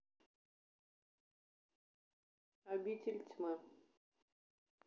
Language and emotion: Russian, neutral